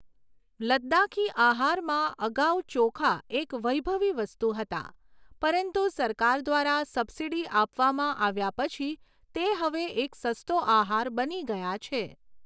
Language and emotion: Gujarati, neutral